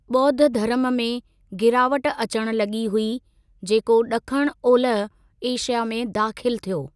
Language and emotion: Sindhi, neutral